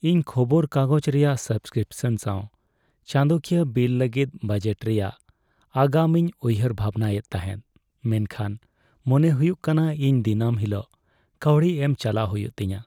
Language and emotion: Santali, sad